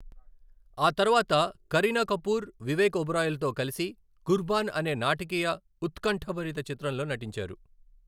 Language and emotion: Telugu, neutral